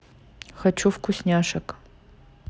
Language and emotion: Russian, neutral